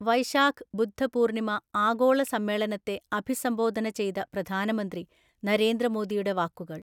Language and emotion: Malayalam, neutral